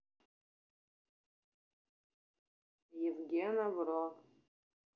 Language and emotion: Russian, neutral